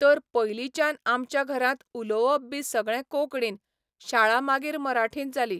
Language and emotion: Goan Konkani, neutral